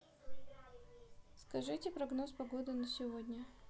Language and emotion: Russian, neutral